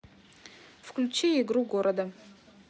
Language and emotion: Russian, neutral